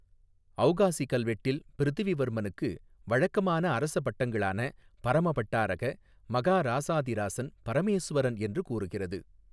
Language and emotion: Tamil, neutral